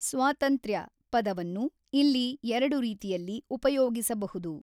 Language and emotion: Kannada, neutral